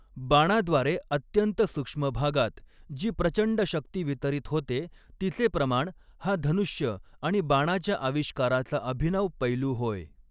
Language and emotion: Marathi, neutral